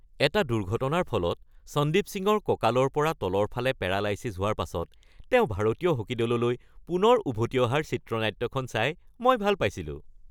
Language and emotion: Assamese, happy